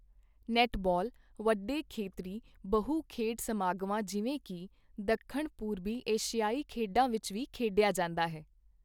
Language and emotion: Punjabi, neutral